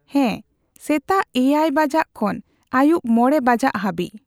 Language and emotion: Santali, neutral